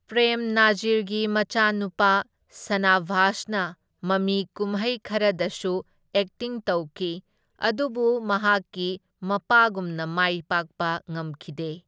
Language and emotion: Manipuri, neutral